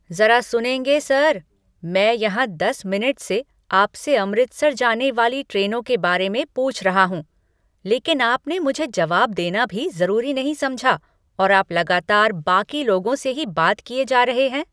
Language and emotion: Hindi, angry